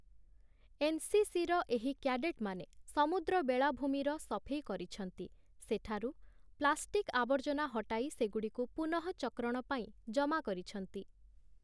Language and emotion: Odia, neutral